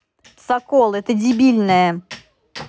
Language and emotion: Russian, angry